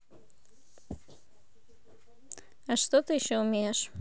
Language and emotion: Russian, neutral